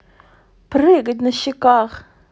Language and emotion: Russian, positive